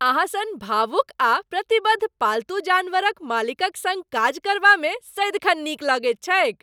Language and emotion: Maithili, happy